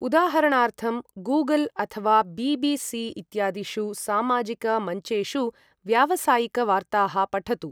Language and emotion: Sanskrit, neutral